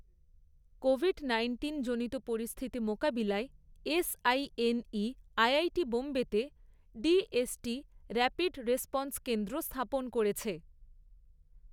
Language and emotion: Bengali, neutral